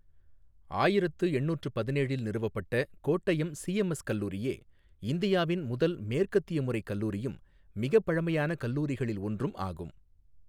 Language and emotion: Tamil, neutral